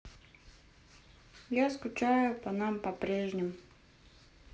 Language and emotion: Russian, sad